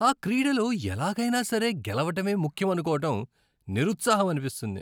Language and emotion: Telugu, disgusted